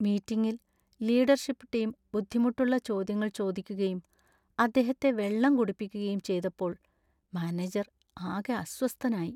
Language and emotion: Malayalam, sad